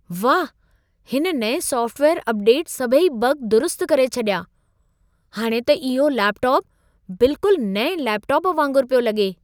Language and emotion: Sindhi, surprised